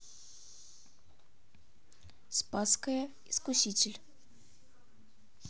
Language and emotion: Russian, neutral